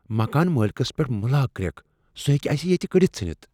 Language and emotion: Kashmiri, fearful